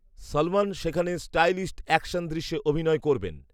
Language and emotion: Bengali, neutral